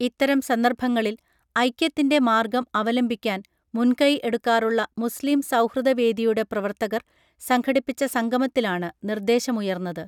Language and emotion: Malayalam, neutral